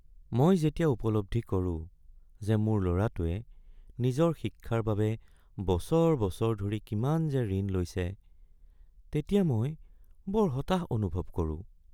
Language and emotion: Assamese, sad